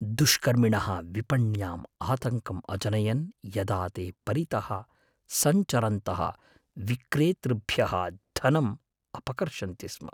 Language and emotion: Sanskrit, fearful